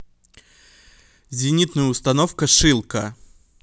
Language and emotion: Russian, neutral